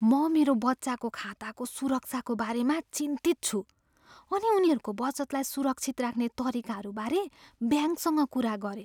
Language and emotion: Nepali, fearful